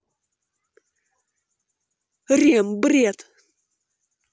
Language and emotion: Russian, angry